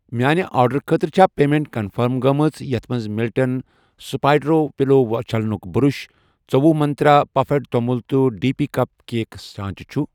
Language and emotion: Kashmiri, neutral